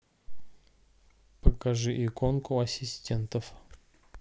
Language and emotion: Russian, neutral